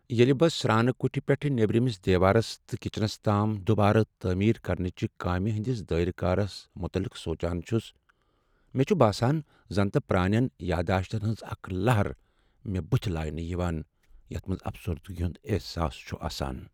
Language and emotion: Kashmiri, sad